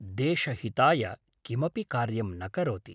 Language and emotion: Sanskrit, neutral